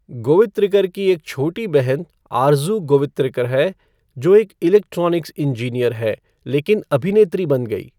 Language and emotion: Hindi, neutral